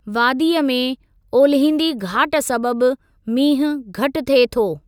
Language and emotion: Sindhi, neutral